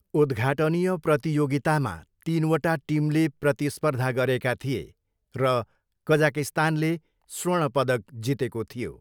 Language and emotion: Nepali, neutral